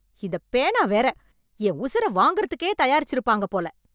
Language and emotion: Tamil, angry